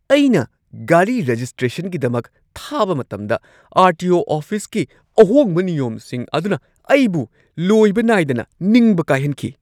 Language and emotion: Manipuri, angry